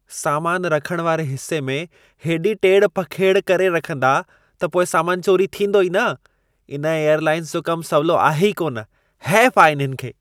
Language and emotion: Sindhi, disgusted